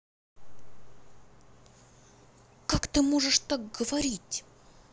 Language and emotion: Russian, angry